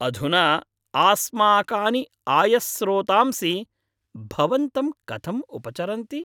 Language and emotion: Sanskrit, happy